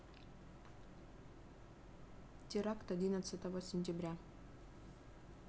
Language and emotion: Russian, neutral